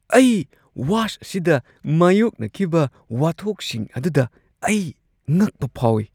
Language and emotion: Manipuri, surprised